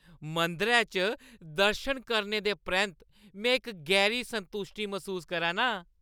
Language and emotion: Dogri, happy